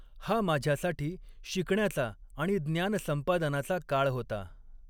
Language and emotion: Marathi, neutral